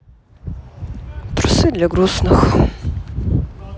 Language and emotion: Russian, sad